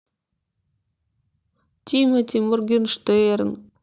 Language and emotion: Russian, sad